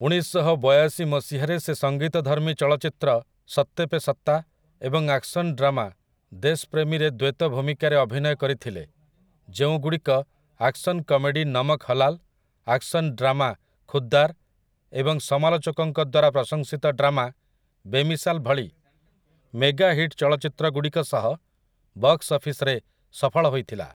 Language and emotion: Odia, neutral